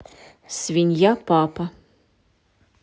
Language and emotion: Russian, neutral